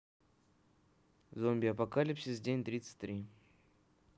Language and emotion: Russian, neutral